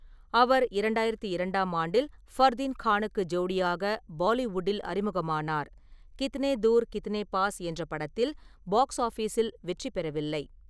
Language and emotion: Tamil, neutral